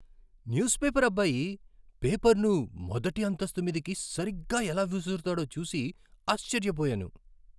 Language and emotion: Telugu, surprised